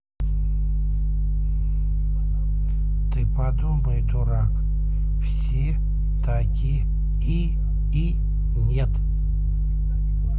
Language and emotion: Russian, neutral